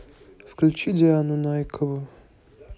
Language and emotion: Russian, neutral